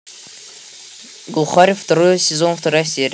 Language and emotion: Russian, neutral